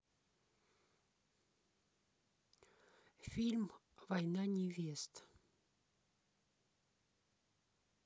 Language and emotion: Russian, neutral